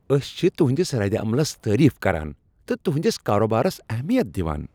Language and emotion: Kashmiri, happy